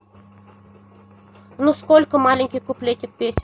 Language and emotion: Russian, neutral